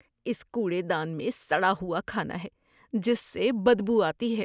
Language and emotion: Urdu, disgusted